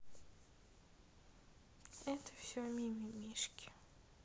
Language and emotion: Russian, sad